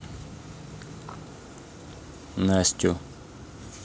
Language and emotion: Russian, neutral